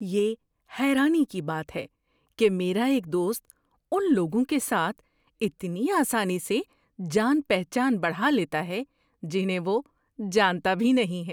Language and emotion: Urdu, surprised